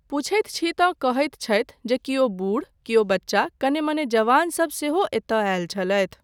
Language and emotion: Maithili, neutral